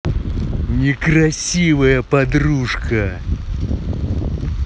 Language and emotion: Russian, angry